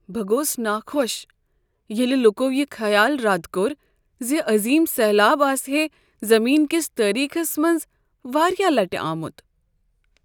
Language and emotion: Kashmiri, sad